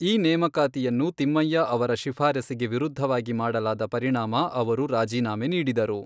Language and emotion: Kannada, neutral